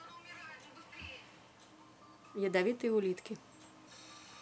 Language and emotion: Russian, neutral